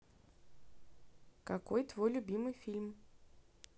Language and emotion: Russian, neutral